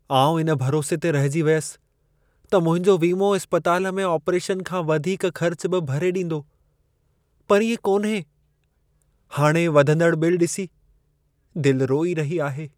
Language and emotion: Sindhi, sad